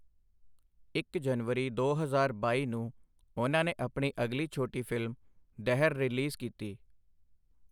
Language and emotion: Punjabi, neutral